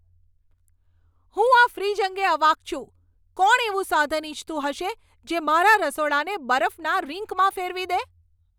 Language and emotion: Gujarati, angry